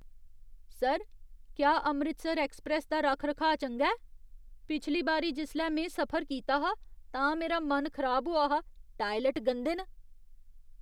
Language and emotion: Dogri, disgusted